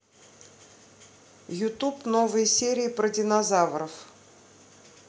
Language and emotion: Russian, neutral